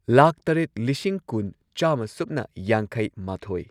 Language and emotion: Manipuri, neutral